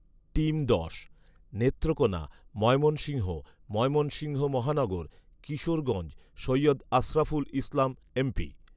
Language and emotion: Bengali, neutral